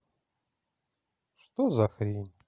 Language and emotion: Russian, neutral